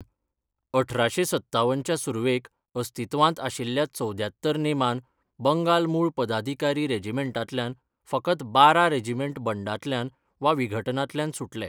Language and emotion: Goan Konkani, neutral